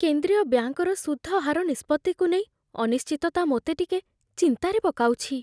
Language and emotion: Odia, fearful